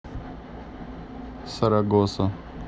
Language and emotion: Russian, neutral